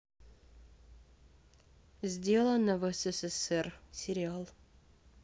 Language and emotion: Russian, neutral